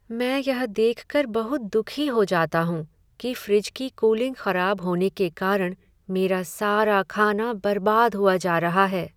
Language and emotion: Hindi, sad